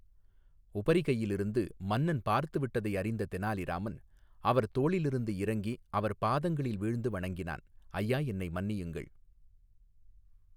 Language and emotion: Tamil, neutral